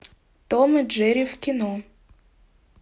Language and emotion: Russian, neutral